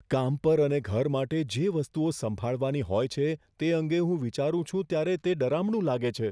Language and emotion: Gujarati, fearful